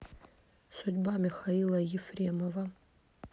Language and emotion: Russian, neutral